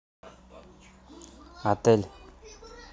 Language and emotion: Russian, neutral